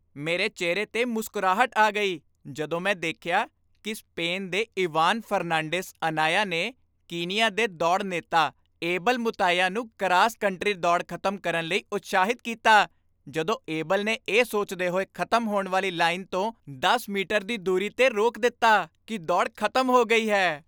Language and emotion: Punjabi, happy